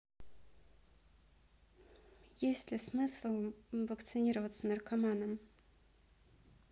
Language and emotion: Russian, neutral